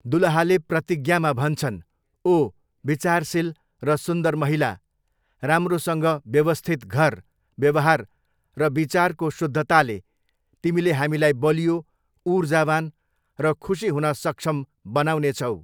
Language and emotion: Nepali, neutral